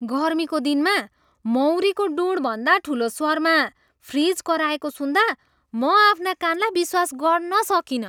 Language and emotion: Nepali, surprised